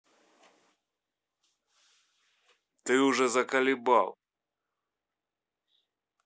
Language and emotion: Russian, angry